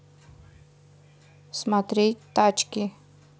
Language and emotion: Russian, neutral